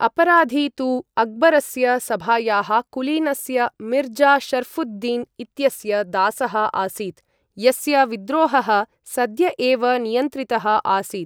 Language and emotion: Sanskrit, neutral